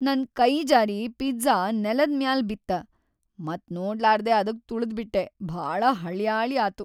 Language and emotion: Kannada, sad